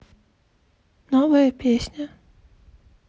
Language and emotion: Russian, sad